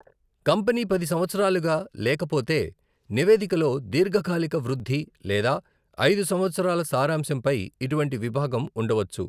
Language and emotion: Telugu, neutral